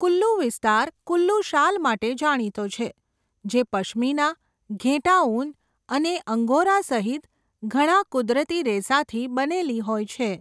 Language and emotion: Gujarati, neutral